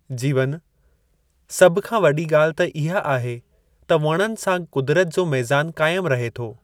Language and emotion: Sindhi, neutral